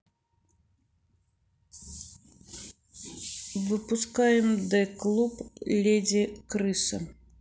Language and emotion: Russian, neutral